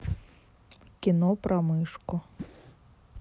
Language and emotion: Russian, neutral